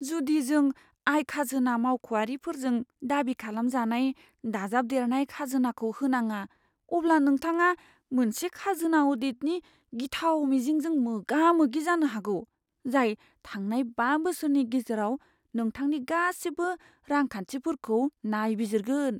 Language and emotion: Bodo, fearful